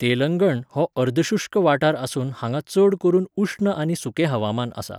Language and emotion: Goan Konkani, neutral